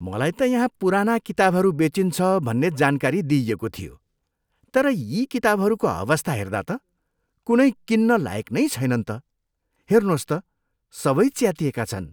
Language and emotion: Nepali, disgusted